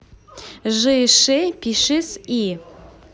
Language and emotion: Russian, positive